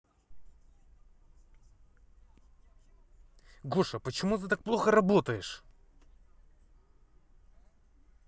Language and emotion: Russian, angry